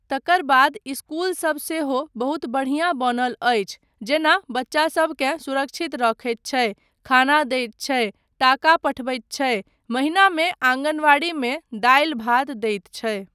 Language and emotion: Maithili, neutral